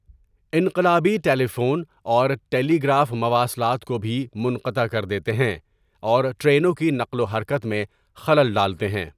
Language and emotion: Urdu, neutral